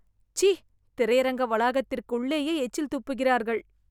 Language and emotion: Tamil, disgusted